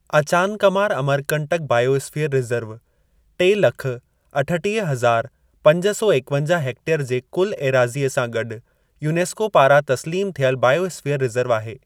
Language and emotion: Sindhi, neutral